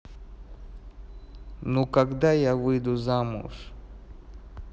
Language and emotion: Russian, neutral